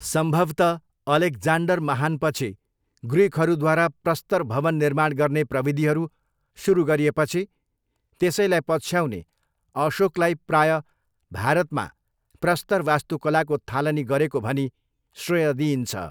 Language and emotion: Nepali, neutral